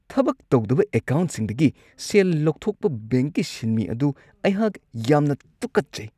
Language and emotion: Manipuri, disgusted